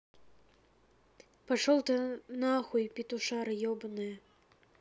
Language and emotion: Russian, angry